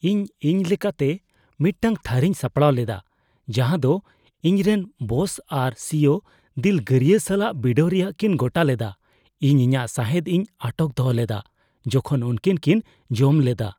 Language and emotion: Santali, fearful